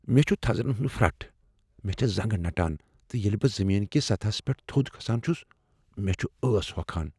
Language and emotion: Kashmiri, fearful